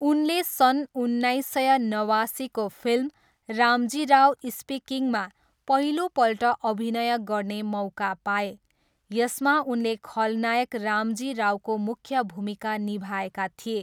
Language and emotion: Nepali, neutral